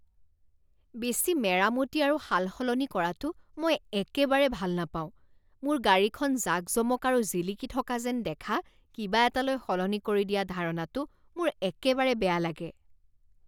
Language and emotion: Assamese, disgusted